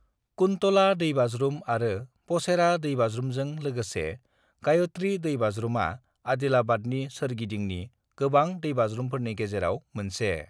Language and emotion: Bodo, neutral